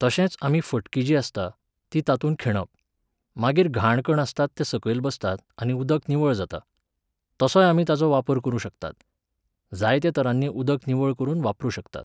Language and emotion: Goan Konkani, neutral